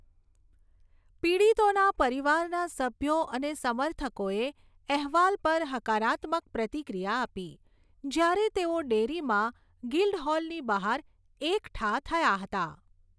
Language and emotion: Gujarati, neutral